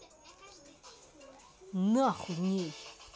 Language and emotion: Russian, angry